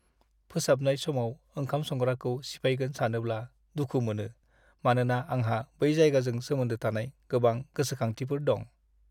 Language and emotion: Bodo, sad